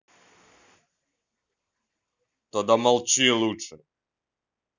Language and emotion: Russian, angry